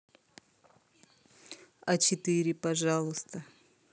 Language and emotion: Russian, neutral